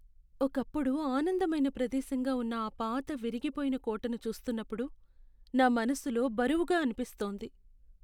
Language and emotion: Telugu, sad